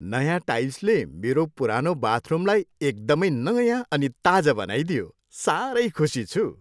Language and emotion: Nepali, happy